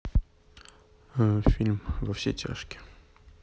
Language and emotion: Russian, neutral